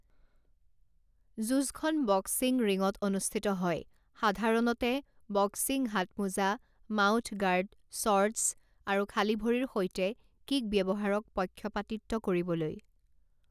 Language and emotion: Assamese, neutral